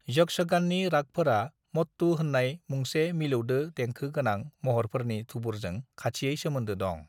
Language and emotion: Bodo, neutral